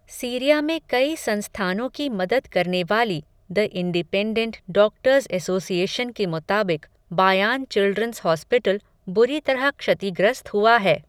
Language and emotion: Hindi, neutral